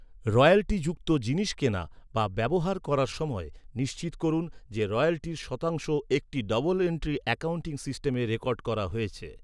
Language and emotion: Bengali, neutral